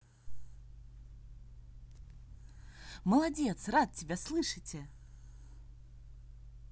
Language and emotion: Russian, positive